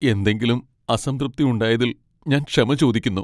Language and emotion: Malayalam, sad